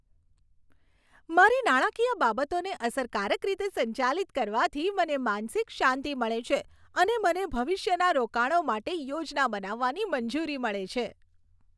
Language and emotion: Gujarati, happy